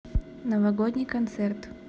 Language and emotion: Russian, neutral